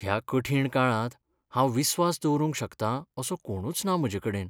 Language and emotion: Goan Konkani, sad